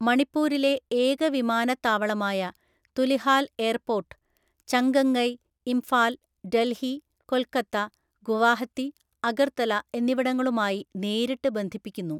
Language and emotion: Malayalam, neutral